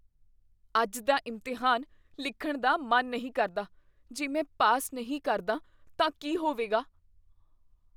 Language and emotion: Punjabi, fearful